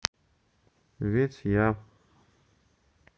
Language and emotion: Russian, neutral